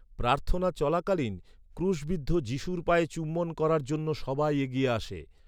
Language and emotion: Bengali, neutral